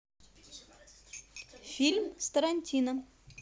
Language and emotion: Russian, positive